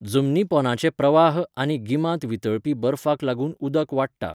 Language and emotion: Goan Konkani, neutral